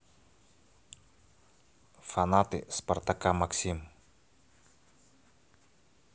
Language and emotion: Russian, neutral